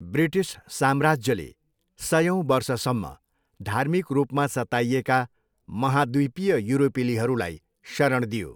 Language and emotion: Nepali, neutral